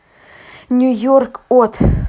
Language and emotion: Russian, neutral